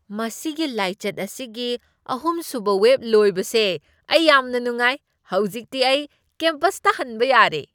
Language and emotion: Manipuri, happy